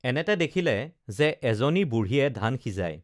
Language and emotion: Assamese, neutral